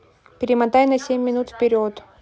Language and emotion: Russian, neutral